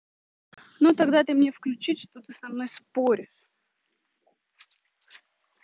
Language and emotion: Russian, angry